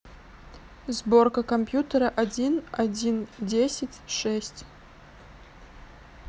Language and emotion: Russian, neutral